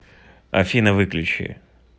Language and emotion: Russian, neutral